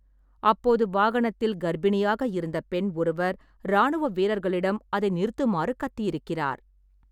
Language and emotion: Tamil, neutral